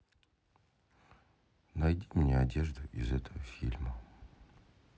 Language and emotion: Russian, neutral